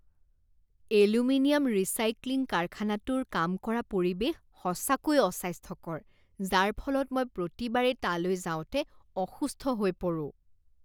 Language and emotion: Assamese, disgusted